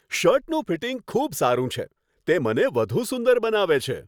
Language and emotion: Gujarati, happy